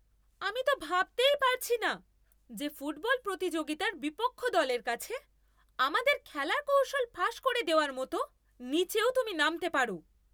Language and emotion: Bengali, angry